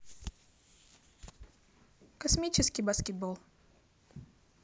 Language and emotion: Russian, neutral